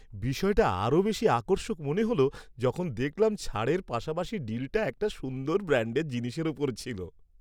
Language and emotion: Bengali, happy